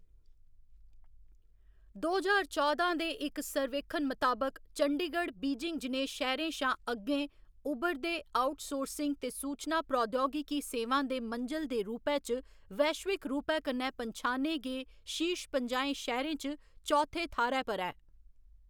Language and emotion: Dogri, neutral